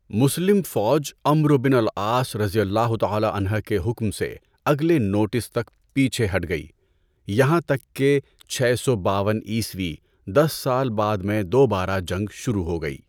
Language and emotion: Urdu, neutral